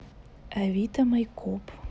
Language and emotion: Russian, neutral